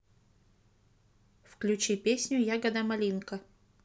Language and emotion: Russian, neutral